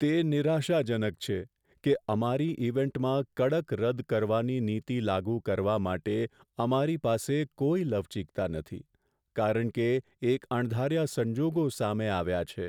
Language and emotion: Gujarati, sad